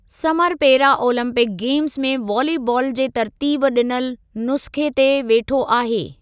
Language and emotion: Sindhi, neutral